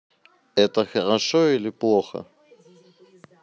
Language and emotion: Russian, neutral